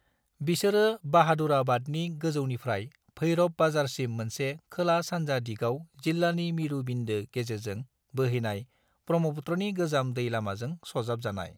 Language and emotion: Bodo, neutral